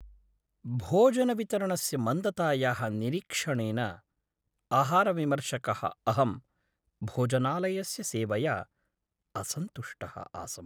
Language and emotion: Sanskrit, sad